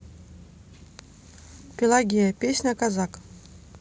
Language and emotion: Russian, neutral